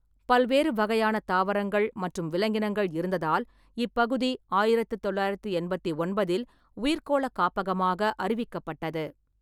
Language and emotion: Tamil, neutral